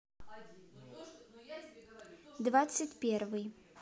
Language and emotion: Russian, neutral